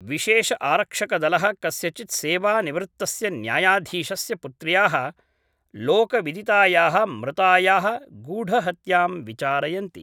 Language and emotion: Sanskrit, neutral